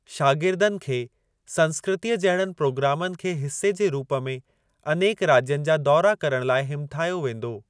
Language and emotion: Sindhi, neutral